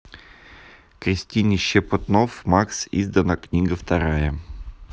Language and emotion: Russian, neutral